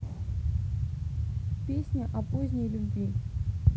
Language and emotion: Russian, neutral